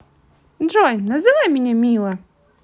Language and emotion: Russian, positive